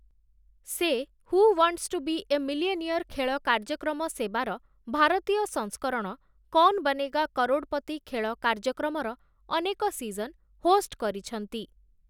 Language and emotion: Odia, neutral